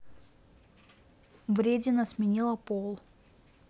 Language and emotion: Russian, neutral